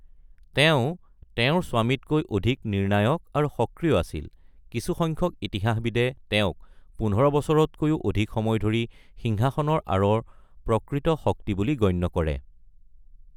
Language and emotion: Assamese, neutral